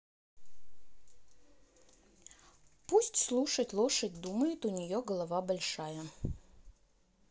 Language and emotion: Russian, neutral